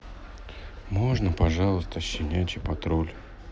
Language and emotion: Russian, sad